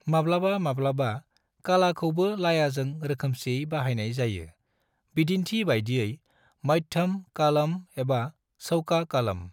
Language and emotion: Bodo, neutral